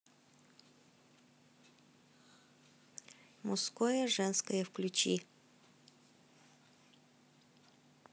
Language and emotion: Russian, neutral